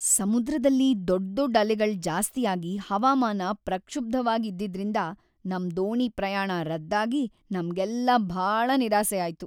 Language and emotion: Kannada, sad